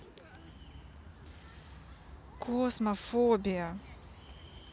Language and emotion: Russian, neutral